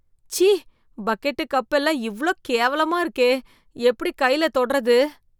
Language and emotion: Tamil, disgusted